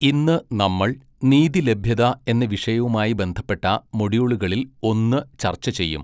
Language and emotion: Malayalam, neutral